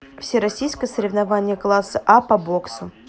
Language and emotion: Russian, neutral